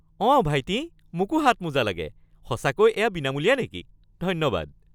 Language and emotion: Assamese, happy